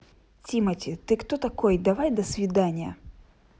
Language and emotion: Russian, angry